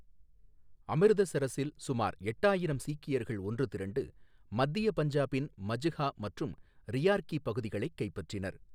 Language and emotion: Tamil, neutral